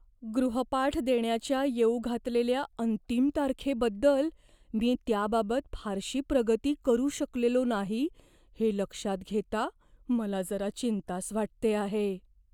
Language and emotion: Marathi, fearful